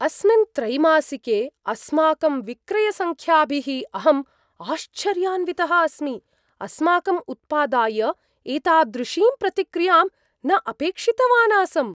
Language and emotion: Sanskrit, surprised